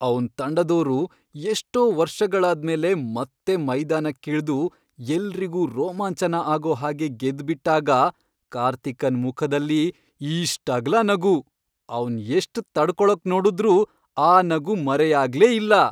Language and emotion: Kannada, happy